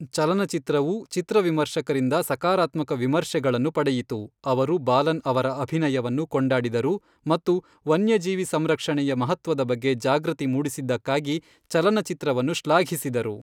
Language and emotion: Kannada, neutral